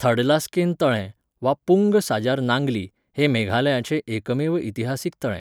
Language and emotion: Goan Konkani, neutral